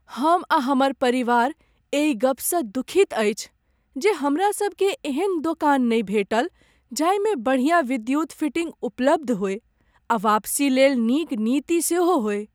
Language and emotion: Maithili, sad